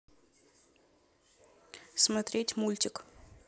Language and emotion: Russian, neutral